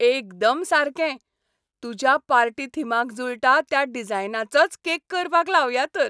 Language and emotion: Goan Konkani, happy